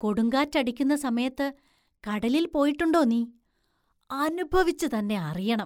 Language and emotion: Malayalam, surprised